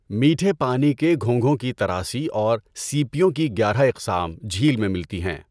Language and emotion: Urdu, neutral